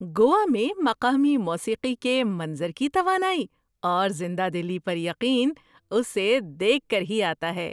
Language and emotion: Urdu, surprised